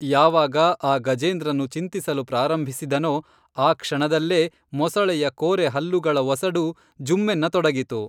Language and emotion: Kannada, neutral